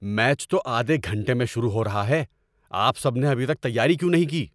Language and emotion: Urdu, angry